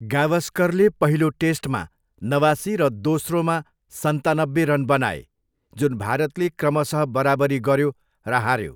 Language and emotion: Nepali, neutral